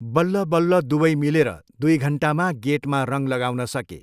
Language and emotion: Nepali, neutral